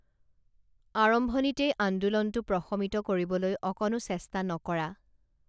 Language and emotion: Assamese, neutral